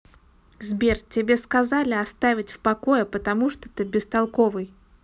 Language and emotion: Russian, angry